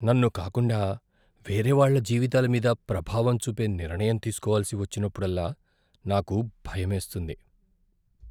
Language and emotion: Telugu, fearful